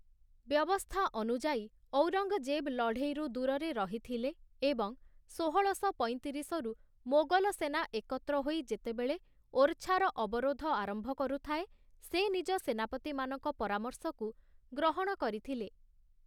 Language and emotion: Odia, neutral